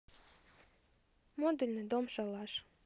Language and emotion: Russian, neutral